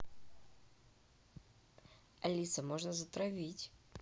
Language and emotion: Russian, neutral